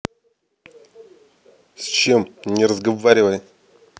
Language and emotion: Russian, angry